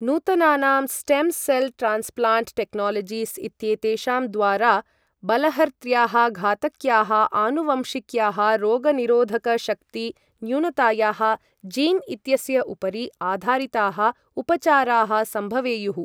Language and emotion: Sanskrit, neutral